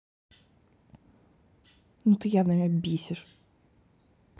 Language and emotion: Russian, angry